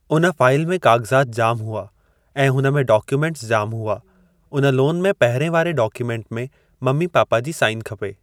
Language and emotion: Sindhi, neutral